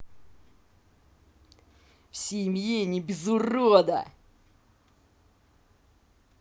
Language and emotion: Russian, angry